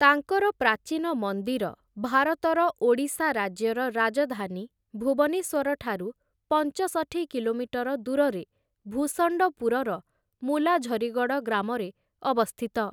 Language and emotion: Odia, neutral